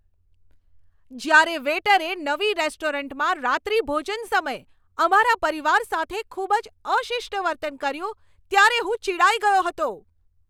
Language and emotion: Gujarati, angry